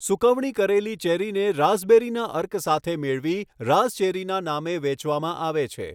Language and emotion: Gujarati, neutral